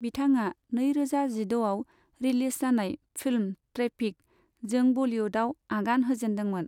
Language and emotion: Bodo, neutral